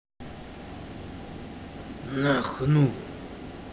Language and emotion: Russian, angry